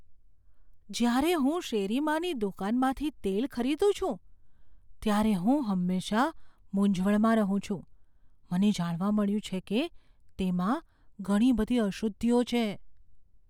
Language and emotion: Gujarati, fearful